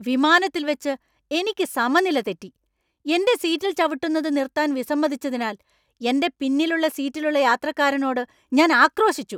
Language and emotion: Malayalam, angry